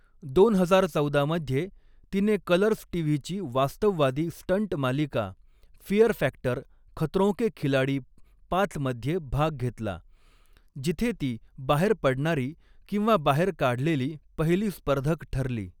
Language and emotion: Marathi, neutral